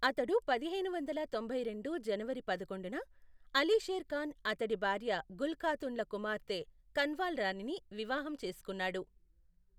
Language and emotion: Telugu, neutral